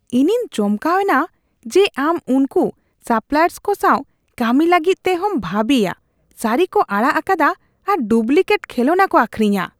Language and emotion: Santali, disgusted